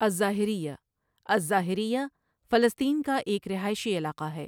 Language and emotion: Urdu, neutral